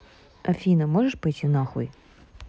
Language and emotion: Russian, neutral